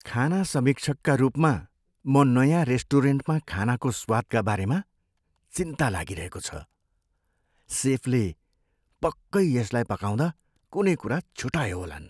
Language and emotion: Nepali, fearful